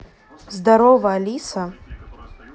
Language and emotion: Russian, neutral